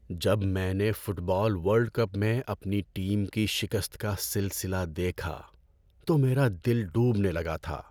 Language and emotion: Urdu, sad